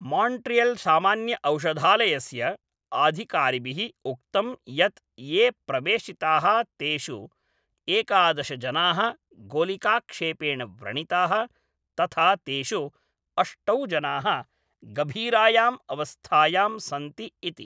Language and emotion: Sanskrit, neutral